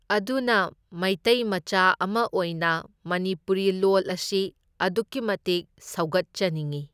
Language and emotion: Manipuri, neutral